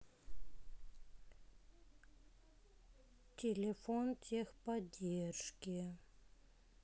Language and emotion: Russian, sad